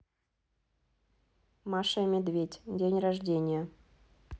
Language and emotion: Russian, neutral